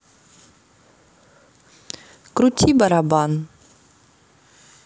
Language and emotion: Russian, neutral